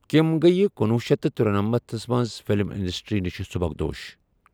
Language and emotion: Kashmiri, neutral